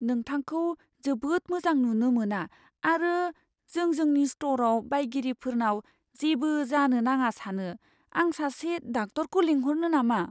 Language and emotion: Bodo, fearful